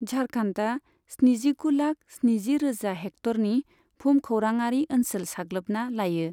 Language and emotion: Bodo, neutral